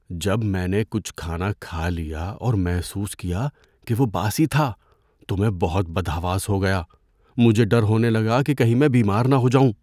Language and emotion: Urdu, fearful